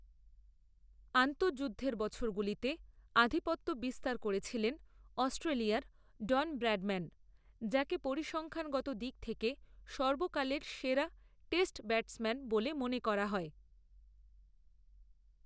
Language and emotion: Bengali, neutral